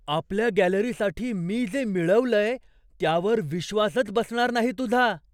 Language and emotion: Marathi, surprised